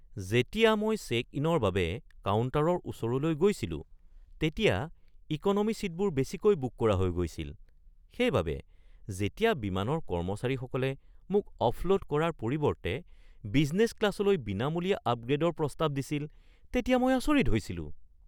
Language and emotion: Assamese, surprised